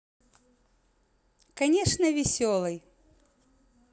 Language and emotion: Russian, positive